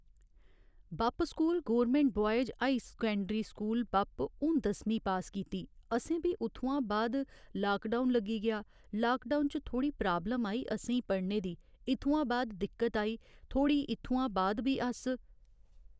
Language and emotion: Dogri, neutral